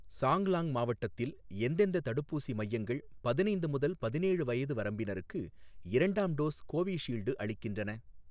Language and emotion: Tamil, neutral